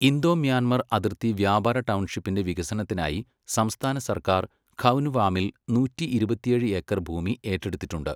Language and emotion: Malayalam, neutral